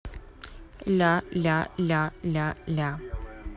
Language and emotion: Russian, neutral